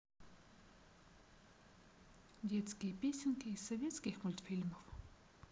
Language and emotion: Russian, neutral